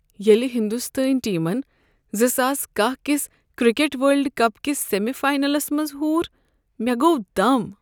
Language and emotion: Kashmiri, sad